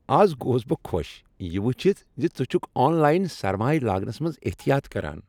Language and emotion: Kashmiri, happy